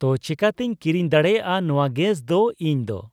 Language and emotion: Santali, neutral